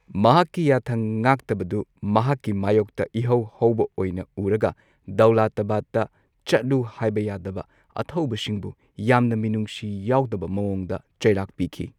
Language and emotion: Manipuri, neutral